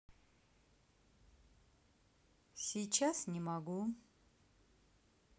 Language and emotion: Russian, neutral